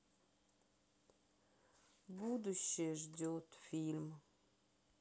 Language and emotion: Russian, sad